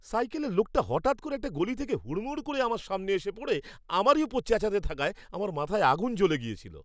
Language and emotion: Bengali, angry